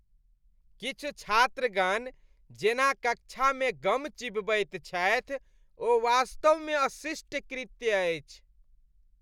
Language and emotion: Maithili, disgusted